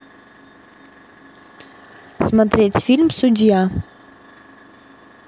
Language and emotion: Russian, neutral